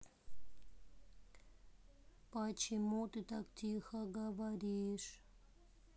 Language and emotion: Russian, sad